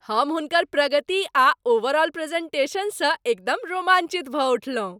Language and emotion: Maithili, happy